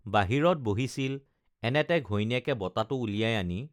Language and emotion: Assamese, neutral